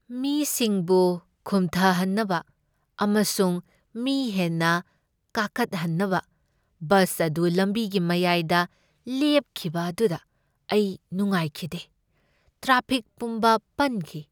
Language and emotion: Manipuri, sad